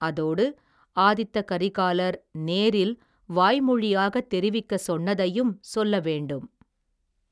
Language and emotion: Tamil, neutral